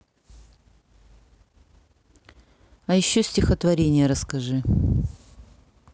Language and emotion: Russian, neutral